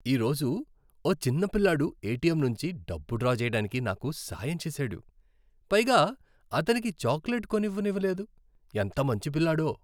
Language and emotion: Telugu, happy